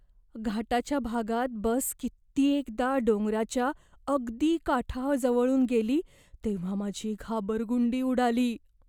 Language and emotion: Marathi, fearful